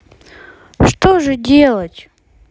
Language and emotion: Russian, sad